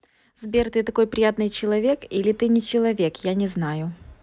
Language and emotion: Russian, positive